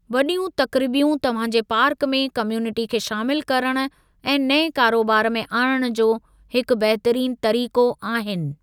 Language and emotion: Sindhi, neutral